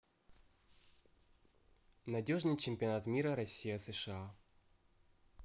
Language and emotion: Russian, neutral